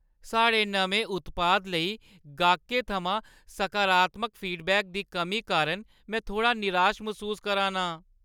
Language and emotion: Dogri, sad